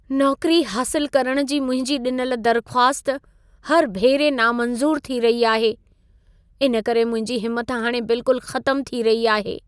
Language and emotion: Sindhi, sad